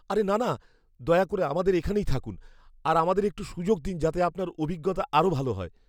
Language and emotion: Bengali, fearful